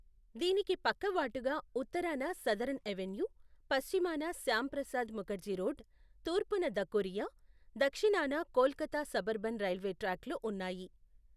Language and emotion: Telugu, neutral